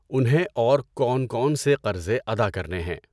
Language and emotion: Urdu, neutral